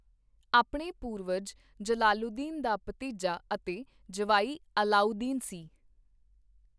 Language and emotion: Punjabi, neutral